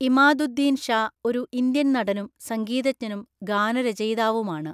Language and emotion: Malayalam, neutral